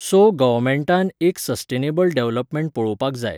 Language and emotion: Goan Konkani, neutral